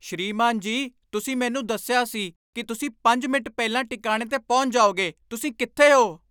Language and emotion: Punjabi, angry